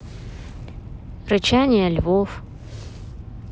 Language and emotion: Russian, neutral